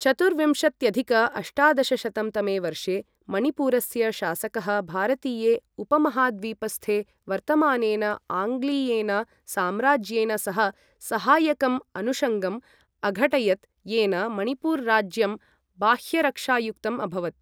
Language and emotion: Sanskrit, neutral